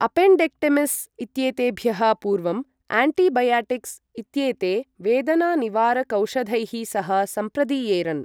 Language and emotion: Sanskrit, neutral